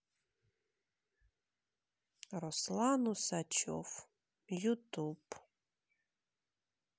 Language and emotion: Russian, sad